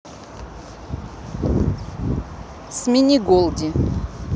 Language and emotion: Russian, neutral